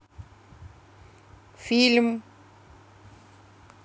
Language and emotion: Russian, neutral